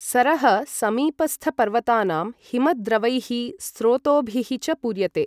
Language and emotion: Sanskrit, neutral